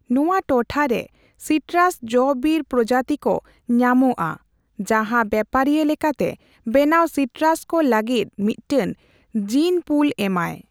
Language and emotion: Santali, neutral